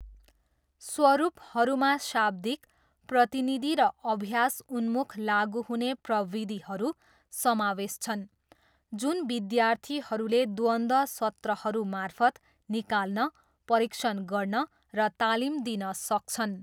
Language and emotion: Nepali, neutral